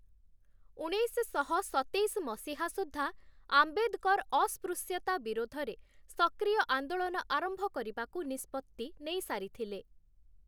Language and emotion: Odia, neutral